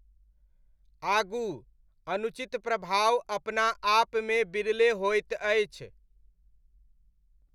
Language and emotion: Maithili, neutral